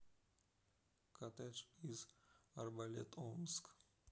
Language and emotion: Russian, neutral